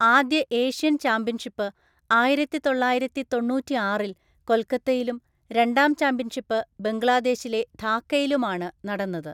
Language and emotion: Malayalam, neutral